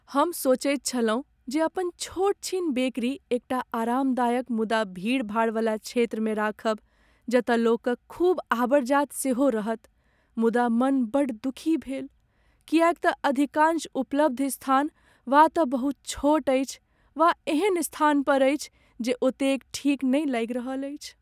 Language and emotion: Maithili, sad